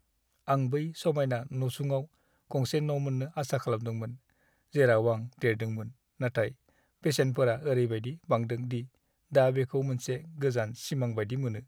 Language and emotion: Bodo, sad